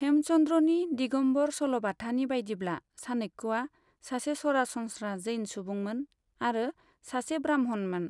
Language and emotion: Bodo, neutral